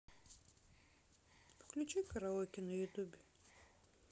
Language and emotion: Russian, neutral